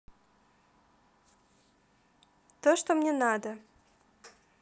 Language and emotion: Russian, positive